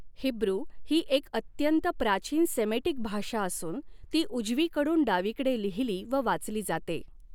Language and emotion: Marathi, neutral